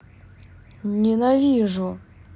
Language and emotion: Russian, angry